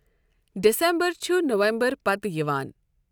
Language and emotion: Kashmiri, neutral